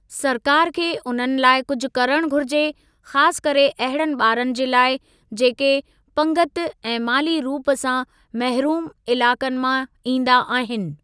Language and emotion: Sindhi, neutral